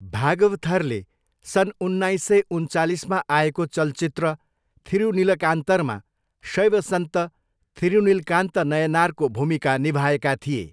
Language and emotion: Nepali, neutral